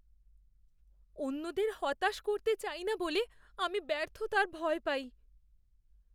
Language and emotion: Bengali, fearful